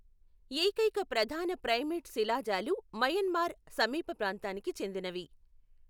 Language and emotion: Telugu, neutral